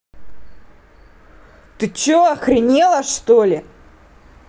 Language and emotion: Russian, angry